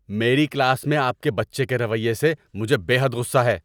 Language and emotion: Urdu, angry